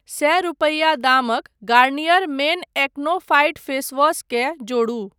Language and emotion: Maithili, neutral